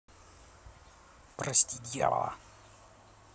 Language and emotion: Russian, neutral